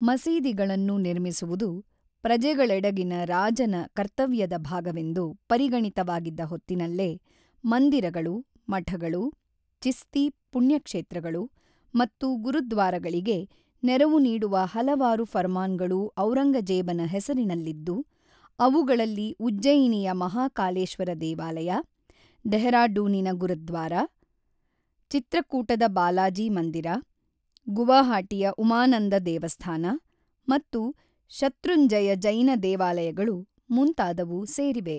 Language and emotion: Kannada, neutral